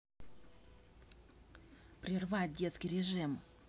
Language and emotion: Russian, angry